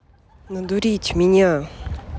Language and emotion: Russian, angry